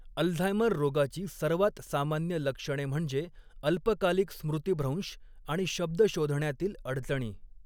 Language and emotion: Marathi, neutral